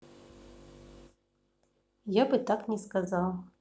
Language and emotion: Russian, neutral